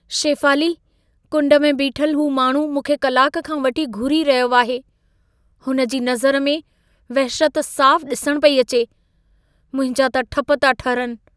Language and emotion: Sindhi, fearful